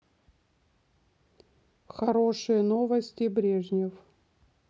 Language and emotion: Russian, neutral